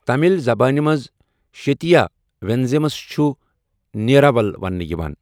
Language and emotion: Kashmiri, neutral